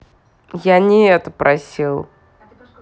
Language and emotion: Russian, angry